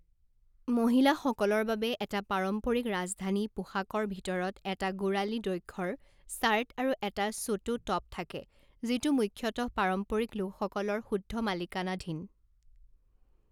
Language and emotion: Assamese, neutral